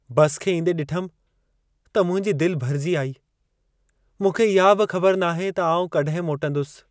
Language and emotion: Sindhi, sad